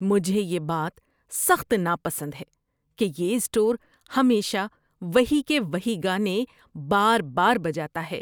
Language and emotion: Urdu, disgusted